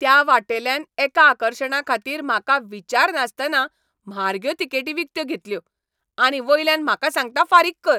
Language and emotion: Goan Konkani, angry